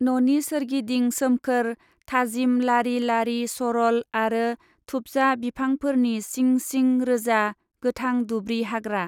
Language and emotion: Bodo, neutral